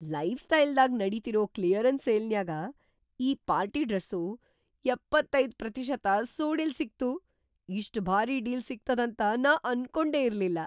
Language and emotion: Kannada, surprised